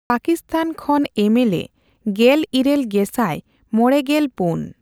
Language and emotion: Santali, neutral